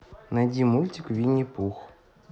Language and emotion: Russian, neutral